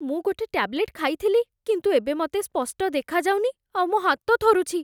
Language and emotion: Odia, fearful